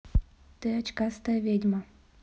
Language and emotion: Russian, neutral